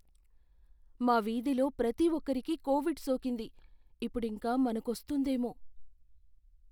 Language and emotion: Telugu, fearful